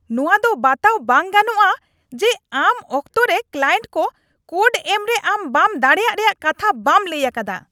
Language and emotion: Santali, angry